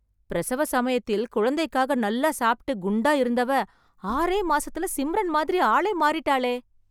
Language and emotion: Tamil, surprised